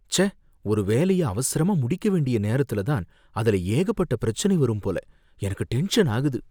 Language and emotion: Tamil, fearful